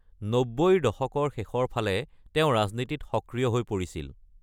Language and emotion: Assamese, neutral